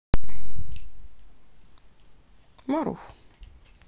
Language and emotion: Russian, neutral